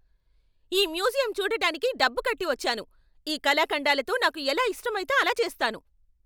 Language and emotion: Telugu, angry